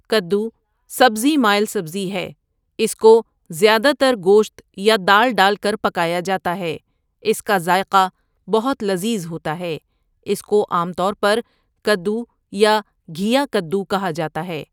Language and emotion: Urdu, neutral